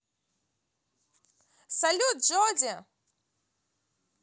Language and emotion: Russian, positive